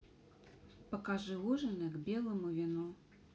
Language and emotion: Russian, neutral